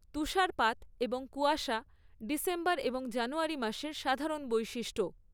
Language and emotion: Bengali, neutral